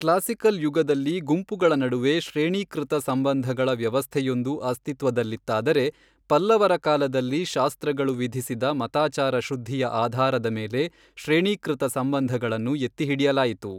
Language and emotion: Kannada, neutral